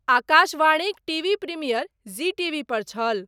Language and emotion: Maithili, neutral